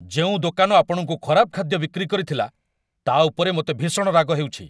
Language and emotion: Odia, angry